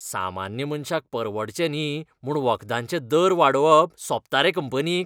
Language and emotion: Goan Konkani, disgusted